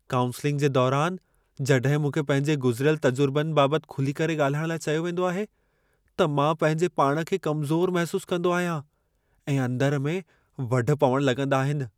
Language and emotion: Sindhi, fearful